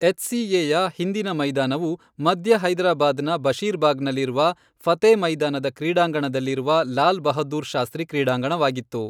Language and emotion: Kannada, neutral